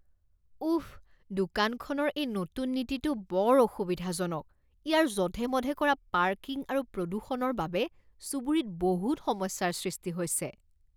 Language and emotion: Assamese, disgusted